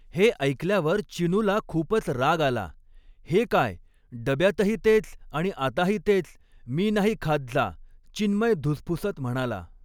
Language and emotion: Marathi, neutral